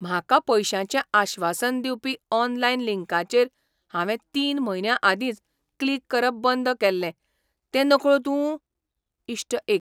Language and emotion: Goan Konkani, surprised